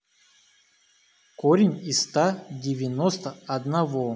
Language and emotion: Russian, neutral